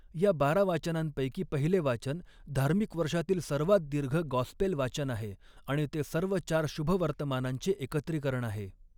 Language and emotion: Marathi, neutral